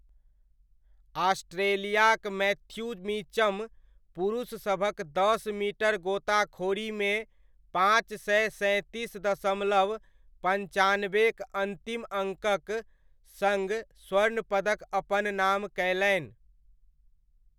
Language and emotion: Maithili, neutral